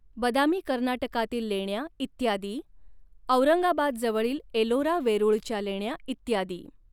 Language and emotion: Marathi, neutral